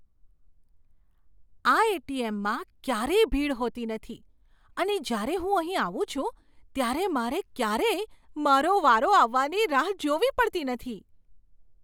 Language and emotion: Gujarati, surprised